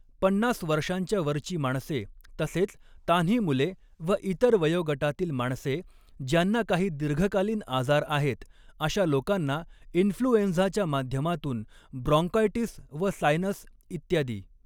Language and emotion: Marathi, neutral